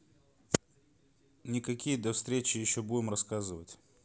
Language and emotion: Russian, neutral